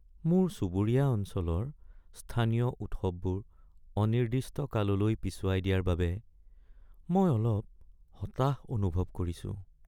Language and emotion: Assamese, sad